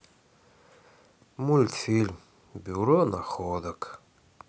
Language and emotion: Russian, sad